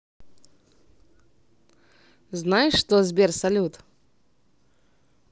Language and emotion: Russian, positive